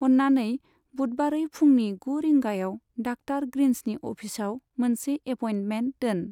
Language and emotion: Bodo, neutral